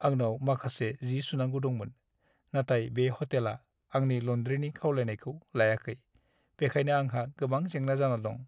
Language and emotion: Bodo, sad